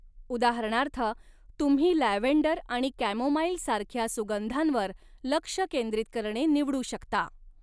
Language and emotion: Marathi, neutral